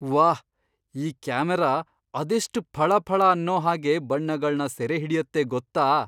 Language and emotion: Kannada, surprised